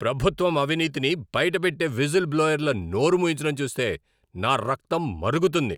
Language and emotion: Telugu, angry